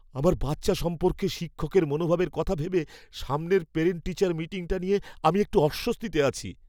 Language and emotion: Bengali, fearful